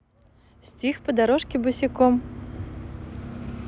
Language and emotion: Russian, positive